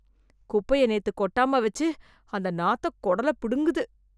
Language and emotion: Tamil, disgusted